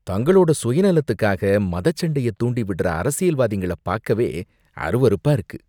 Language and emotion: Tamil, disgusted